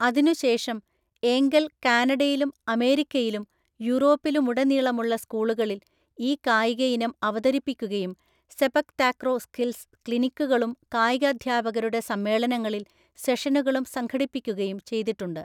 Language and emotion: Malayalam, neutral